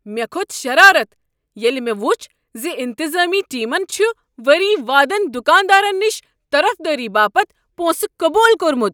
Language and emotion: Kashmiri, angry